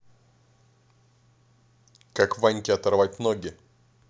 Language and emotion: Russian, angry